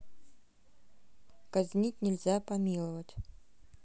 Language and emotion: Russian, neutral